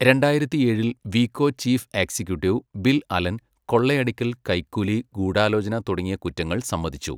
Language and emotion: Malayalam, neutral